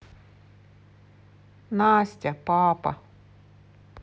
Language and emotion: Russian, sad